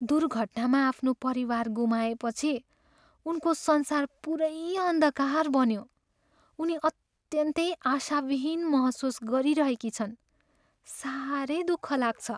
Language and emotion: Nepali, sad